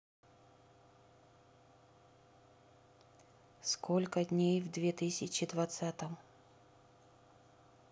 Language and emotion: Russian, neutral